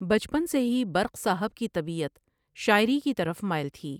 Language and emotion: Urdu, neutral